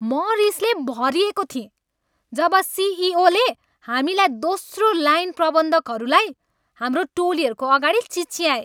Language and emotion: Nepali, angry